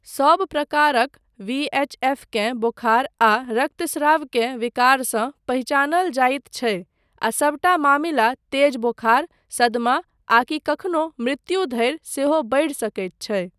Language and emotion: Maithili, neutral